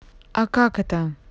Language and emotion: Russian, neutral